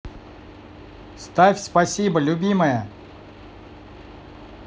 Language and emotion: Russian, positive